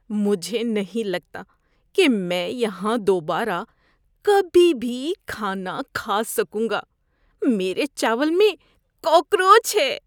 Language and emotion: Urdu, disgusted